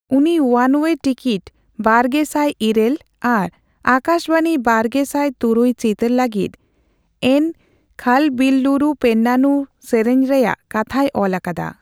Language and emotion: Santali, neutral